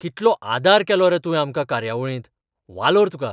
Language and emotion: Goan Konkani, surprised